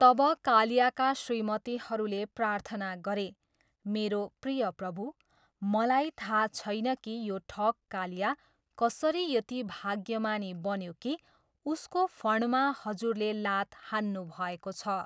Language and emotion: Nepali, neutral